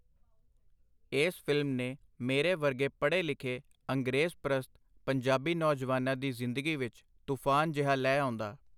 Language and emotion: Punjabi, neutral